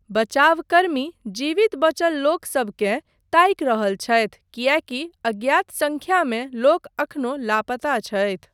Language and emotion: Maithili, neutral